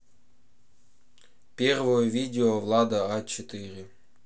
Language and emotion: Russian, neutral